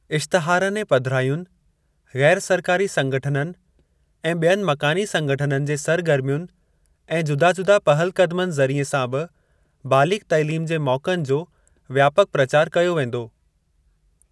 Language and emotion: Sindhi, neutral